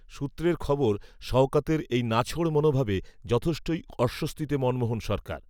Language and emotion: Bengali, neutral